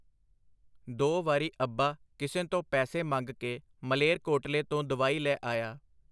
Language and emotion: Punjabi, neutral